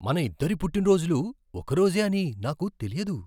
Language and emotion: Telugu, surprised